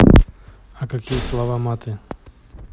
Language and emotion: Russian, neutral